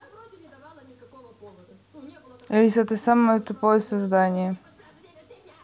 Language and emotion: Russian, neutral